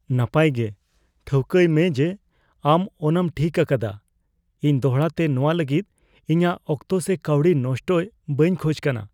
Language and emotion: Santali, fearful